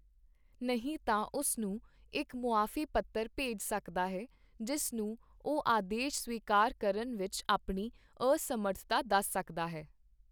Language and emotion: Punjabi, neutral